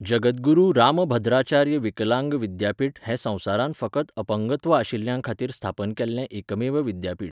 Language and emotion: Goan Konkani, neutral